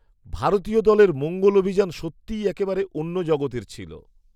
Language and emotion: Bengali, surprised